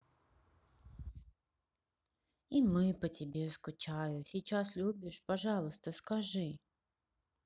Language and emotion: Russian, sad